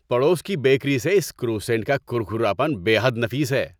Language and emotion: Urdu, happy